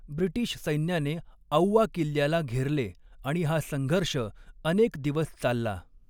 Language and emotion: Marathi, neutral